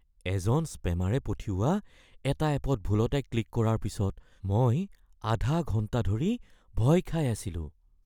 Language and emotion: Assamese, fearful